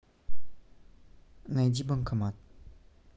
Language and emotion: Russian, neutral